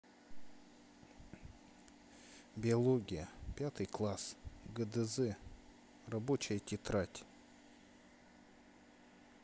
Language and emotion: Russian, neutral